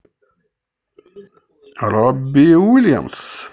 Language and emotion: Russian, positive